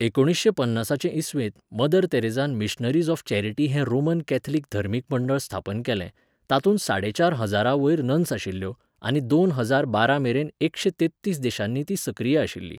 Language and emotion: Goan Konkani, neutral